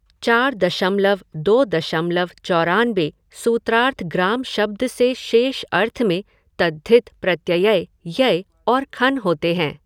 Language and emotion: Hindi, neutral